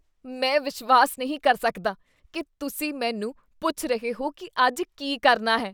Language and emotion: Punjabi, disgusted